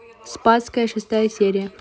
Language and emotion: Russian, neutral